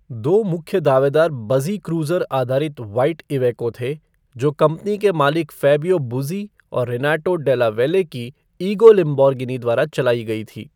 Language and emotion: Hindi, neutral